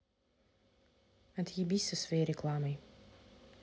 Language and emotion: Russian, angry